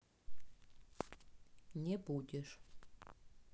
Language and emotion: Russian, neutral